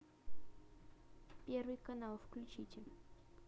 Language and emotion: Russian, neutral